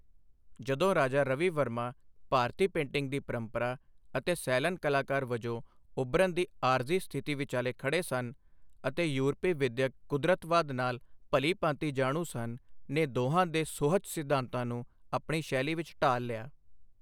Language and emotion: Punjabi, neutral